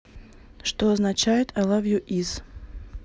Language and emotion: Russian, neutral